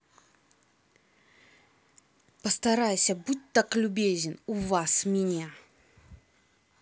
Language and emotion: Russian, angry